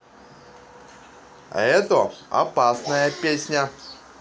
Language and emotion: Russian, positive